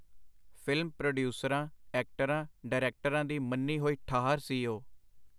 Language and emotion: Punjabi, neutral